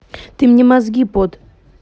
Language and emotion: Russian, angry